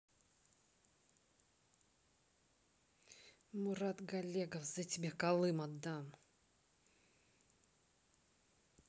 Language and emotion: Russian, angry